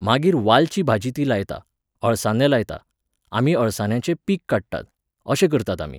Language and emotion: Goan Konkani, neutral